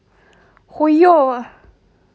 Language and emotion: Russian, positive